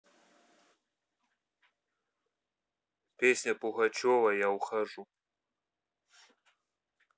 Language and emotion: Russian, neutral